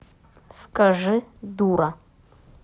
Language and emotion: Russian, neutral